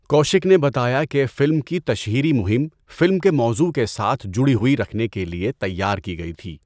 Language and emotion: Urdu, neutral